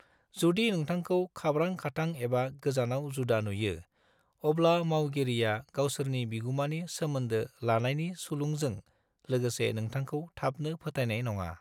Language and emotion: Bodo, neutral